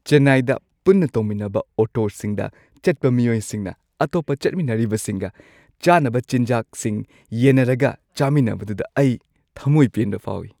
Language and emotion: Manipuri, happy